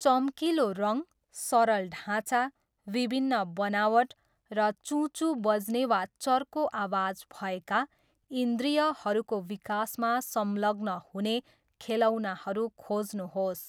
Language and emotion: Nepali, neutral